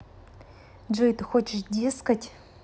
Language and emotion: Russian, neutral